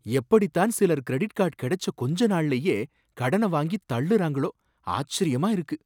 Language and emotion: Tamil, surprised